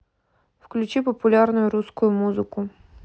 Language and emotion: Russian, neutral